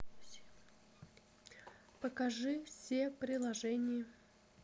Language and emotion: Russian, neutral